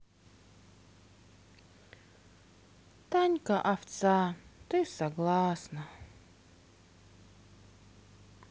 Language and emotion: Russian, sad